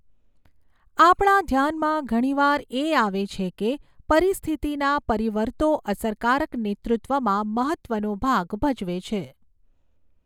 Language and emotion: Gujarati, neutral